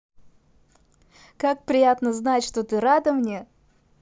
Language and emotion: Russian, positive